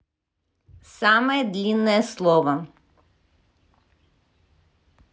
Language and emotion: Russian, neutral